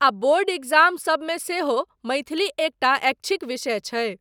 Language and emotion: Maithili, neutral